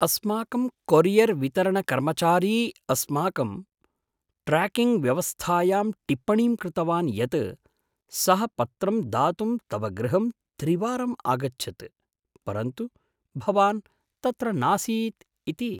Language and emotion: Sanskrit, surprised